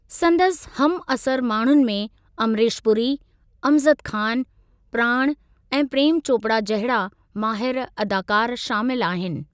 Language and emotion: Sindhi, neutral